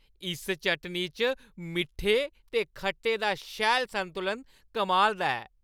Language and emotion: Dogri, happy